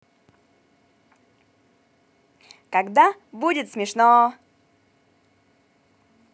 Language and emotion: Russian, positive